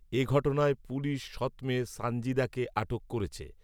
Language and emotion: Bengali, neutral